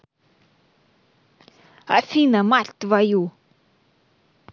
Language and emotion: Russian, angry